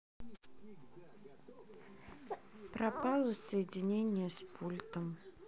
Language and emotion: Russian, neutral